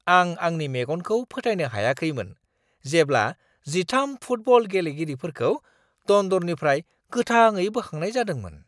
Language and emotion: Bodo, surprised